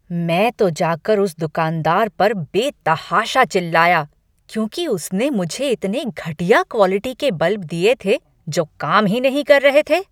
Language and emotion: Hindi, angry